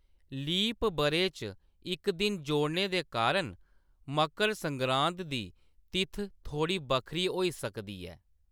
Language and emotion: Dogri, neutral